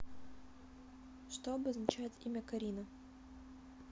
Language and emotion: Russian, neutral